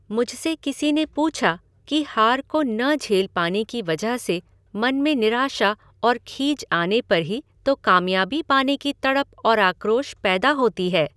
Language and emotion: Hindi, neutral